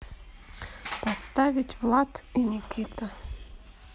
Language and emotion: Russian, neutral